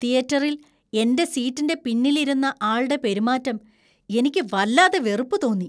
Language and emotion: Malayalam, disgusted